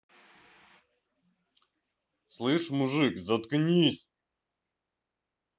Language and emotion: Russian, angry